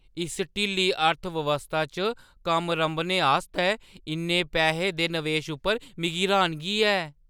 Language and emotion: Dogri, surprised